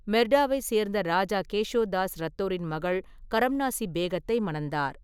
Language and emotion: Tamil, neutral